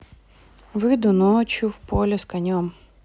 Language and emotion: Russian, neutral